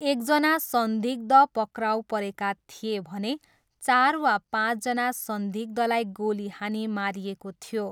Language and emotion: Nepali, neutral